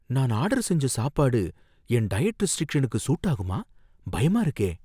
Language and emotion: Tamil, fearful